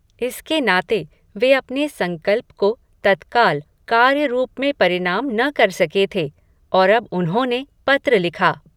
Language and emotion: Hindi, neutral